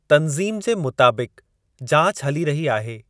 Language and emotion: Sindhi, neutral